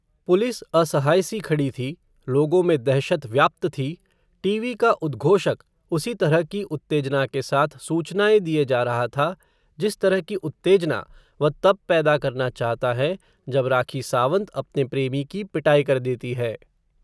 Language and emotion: Hindi, neutral